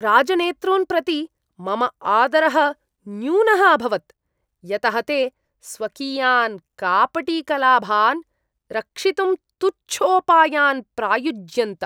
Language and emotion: Sanskrit, disgusted